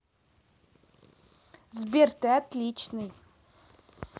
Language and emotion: Russian, positive